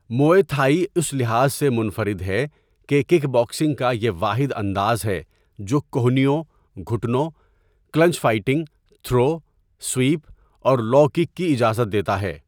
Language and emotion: Urdu, neutral